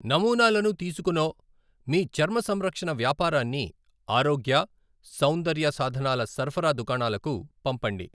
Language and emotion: Telugu, neutral